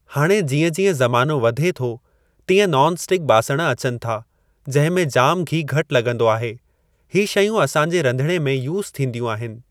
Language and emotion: Sindhi, neutral